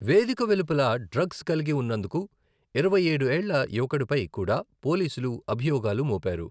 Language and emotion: Telugu, neutral